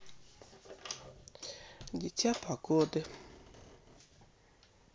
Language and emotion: Russian, sad